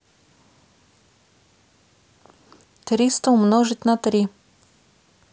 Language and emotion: Russian, neutral